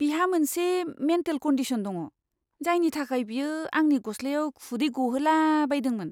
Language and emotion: Bodo, disgusted